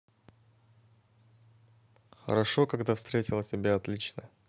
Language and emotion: Russian, positive